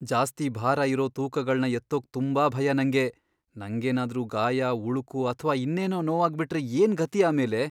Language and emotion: Kannada, fearful